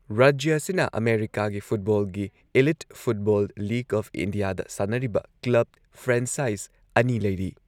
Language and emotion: Manipuri, neutral